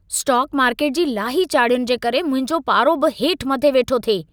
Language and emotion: Sindhi, angry